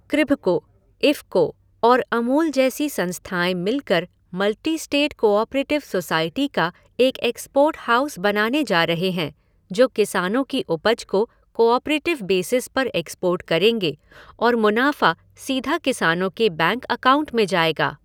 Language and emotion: Hindi, neutral